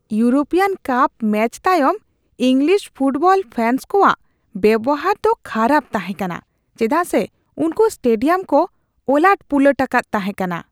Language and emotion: Santali, disgusted